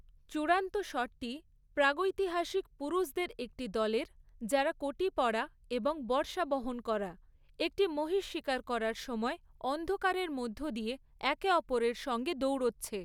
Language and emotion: Bengali, neutral